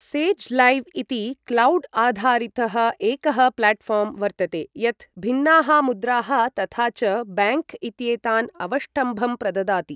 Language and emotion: Sanskrit, neutral